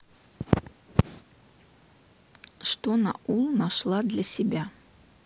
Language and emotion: Russian, neutral